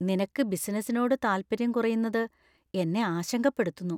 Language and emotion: Malayalam, fearful